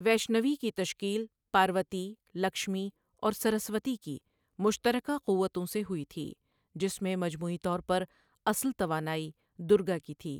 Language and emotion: Urdu, neutral